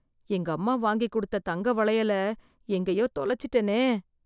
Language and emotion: Tamil, fearful